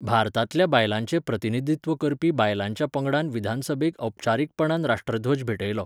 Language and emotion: Goan Konkani, neutral